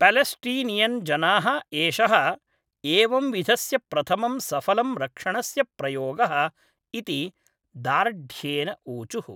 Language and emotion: Sanskrit, neutral